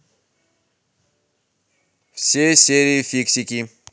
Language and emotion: Russian, neutral